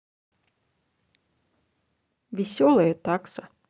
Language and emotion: Russian, positive